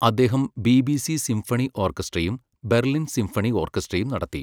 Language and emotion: Malayalam, neutral